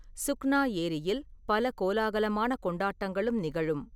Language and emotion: Tamil, neutral